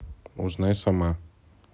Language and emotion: Russian, neutral